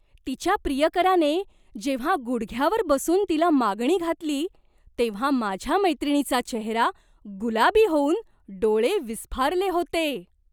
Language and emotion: Marathi, surprised